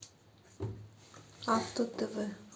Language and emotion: Russian, neutral